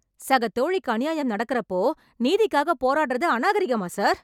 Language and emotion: Tamil, angry